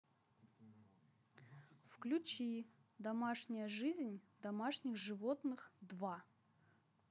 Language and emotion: Russian, neutral